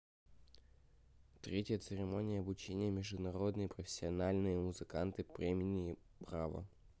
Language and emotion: Russian, neutral